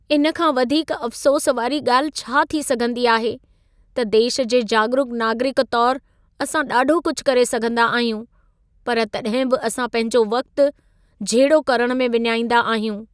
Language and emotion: Sindhi, sad